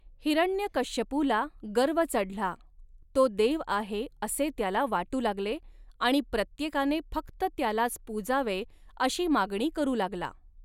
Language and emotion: Marathi, neutral